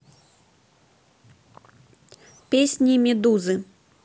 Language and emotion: Russian, neutral